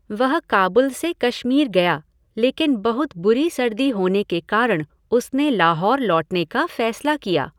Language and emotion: Hindi, neutral